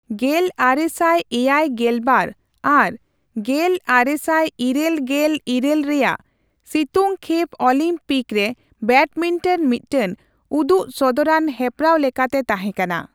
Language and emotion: Santali, neutral